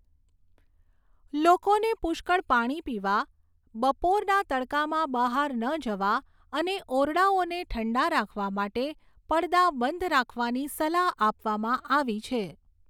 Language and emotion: Gujarati, neutral